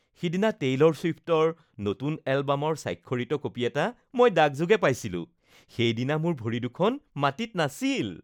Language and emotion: Assamese, happy